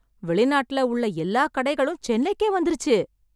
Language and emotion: Tamil, surprised